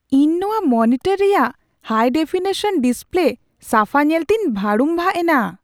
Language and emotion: Santali, surprised